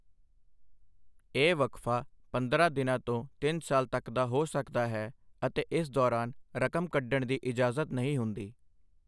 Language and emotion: Punjabi, neutral